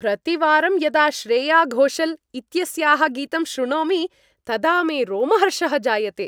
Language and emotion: Sanskrit, happy